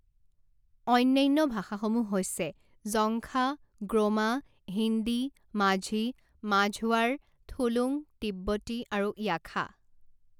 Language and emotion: Assamese, neutral